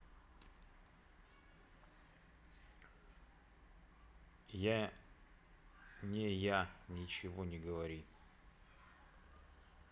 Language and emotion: Russian, neutral